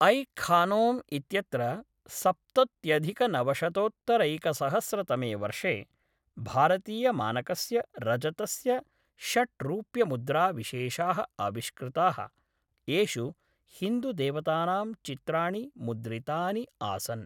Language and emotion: Sanskrit, neutral